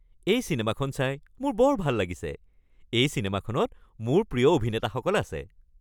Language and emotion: Assamese, happy